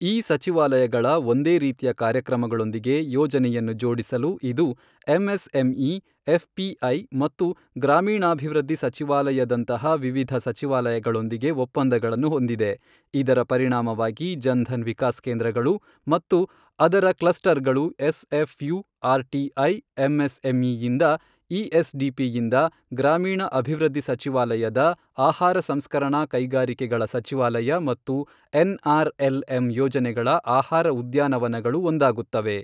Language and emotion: Kannada, neutral